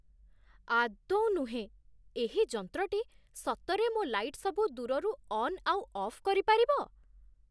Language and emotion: Odia, surprised